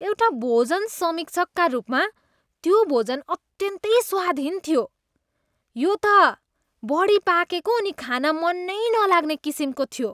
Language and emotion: Nepali, disgusted